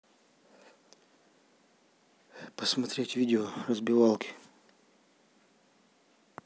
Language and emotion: Russian, neutral